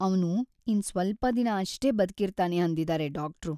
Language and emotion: Kannada, sad